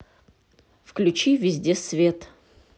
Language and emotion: Russian, neutral